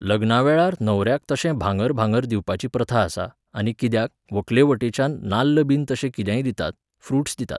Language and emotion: Goan Konkani, neutral